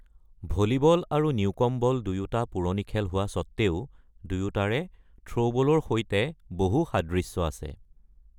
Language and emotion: Assamese, neutral